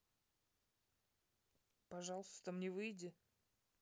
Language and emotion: Russian, neutral